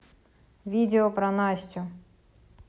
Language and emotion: Russian, neutral